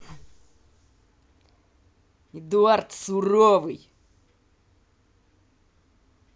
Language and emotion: Russian, angry